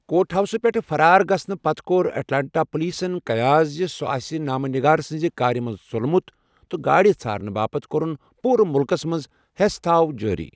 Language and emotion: Kashmiri, neutral